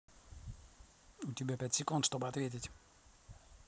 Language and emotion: Russian, angry